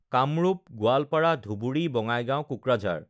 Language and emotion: Assamese, neutral